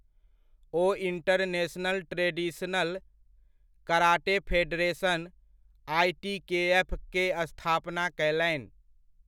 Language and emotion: Maithili, neutral